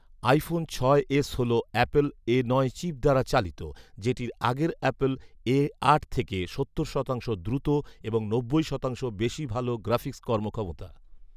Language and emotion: Bengali, neutral